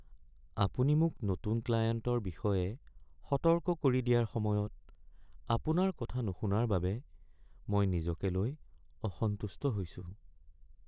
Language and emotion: Assamese, sad